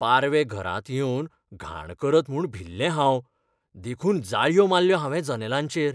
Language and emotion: Goan Konkani, fearful